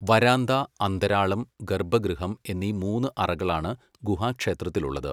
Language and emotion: Malayalam, neutral